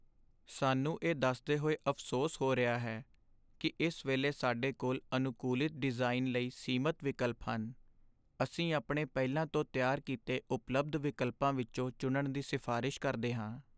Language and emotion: Punjabi, sad